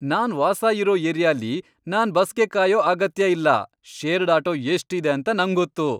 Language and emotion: Kannada, happy